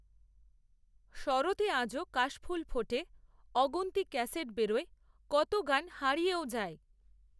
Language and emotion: Bengali, neutral